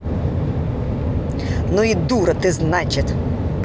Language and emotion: Russian, angry